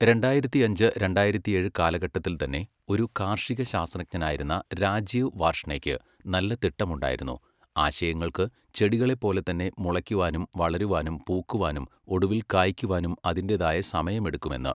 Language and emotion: Malayalam, neutral